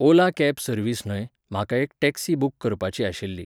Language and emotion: Goan Konkani, neutral